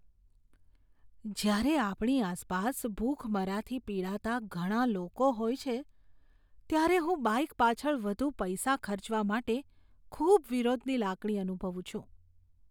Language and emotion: Gujarati, disgusted